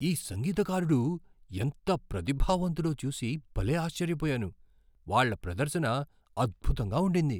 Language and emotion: Telugu, surprised